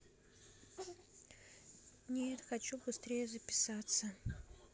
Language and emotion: Russian, neutral